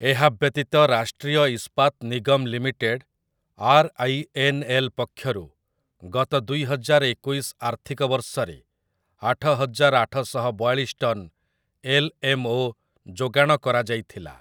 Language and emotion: Odia, neutral